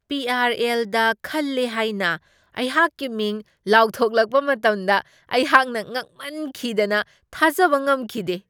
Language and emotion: Manipuri, surprised